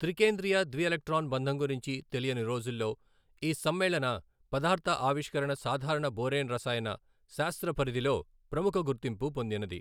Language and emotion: Telugu, neutral